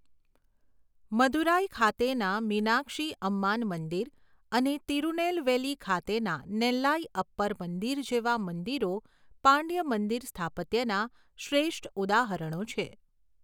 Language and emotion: Gujarati, neutral